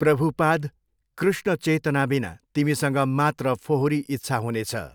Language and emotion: Nepali, neutral